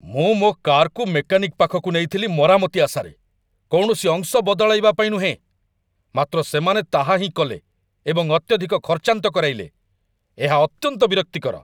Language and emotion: Odia, angry